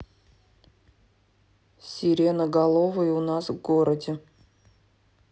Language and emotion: Russian, neutral